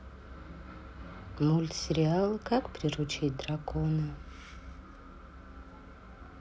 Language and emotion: Russian, sad